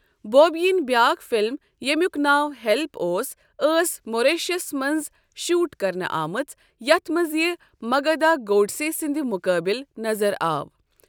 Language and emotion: Kashmiri, neutral